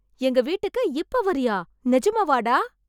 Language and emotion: Tamil, surprised